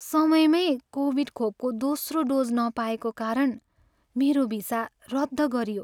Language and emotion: Nepali, sad